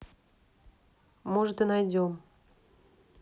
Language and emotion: Russian, angry